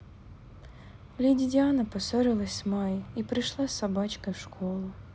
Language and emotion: Russian, sad